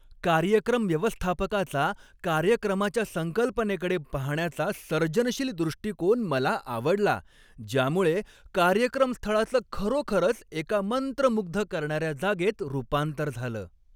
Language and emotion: Marathi, happy